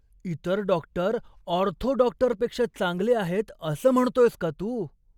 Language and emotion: Marathi, surprised